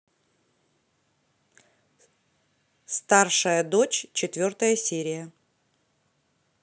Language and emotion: Russian, neutral